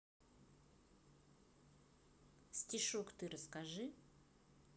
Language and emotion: Russian, neutral